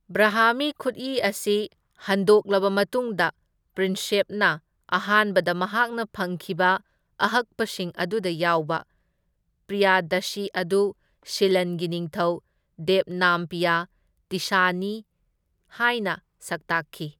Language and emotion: Manipuri, neutral